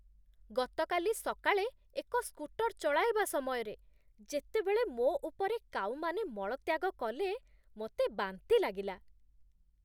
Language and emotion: Odia, disgusted